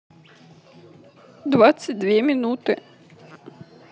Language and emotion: Russian, sad